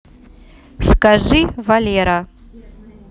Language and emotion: Russian, neutral